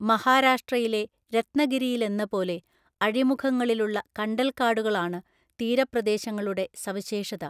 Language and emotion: Malayalam, neutral